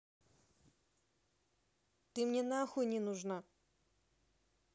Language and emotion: Russian, angry